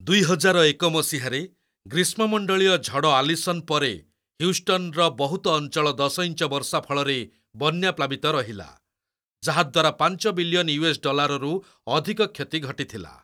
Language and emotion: Odia, neutral